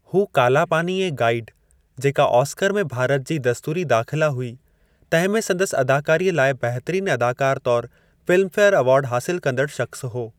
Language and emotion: Sindhi, neutral